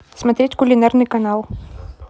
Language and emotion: Russian, neutral